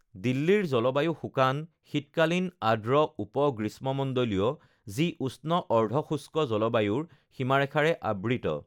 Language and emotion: Assamese, neutral